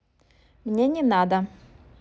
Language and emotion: Russian, neutral